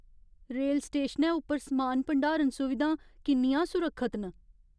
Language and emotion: Dogri, fearful